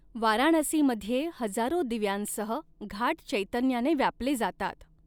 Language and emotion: Marathi, neutral